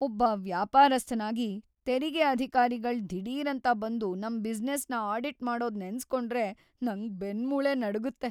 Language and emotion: Kannada, fearful